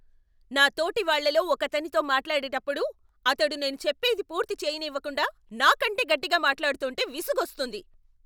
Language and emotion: Telugu, angry